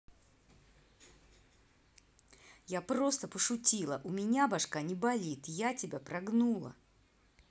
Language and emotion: Russian, angry